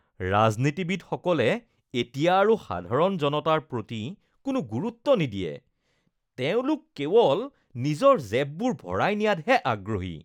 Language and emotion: Assamese, disgusted